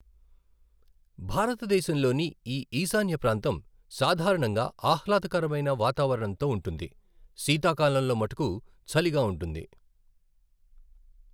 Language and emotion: Telugu, neutral